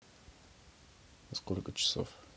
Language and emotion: Russian, neutral